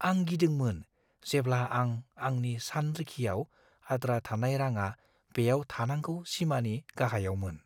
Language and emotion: Bodo, fearful